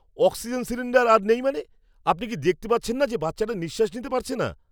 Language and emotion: Bengali, angry